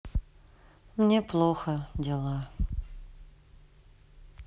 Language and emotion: Russian, sad